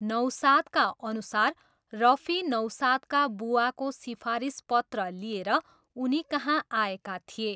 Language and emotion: Nepali, neutral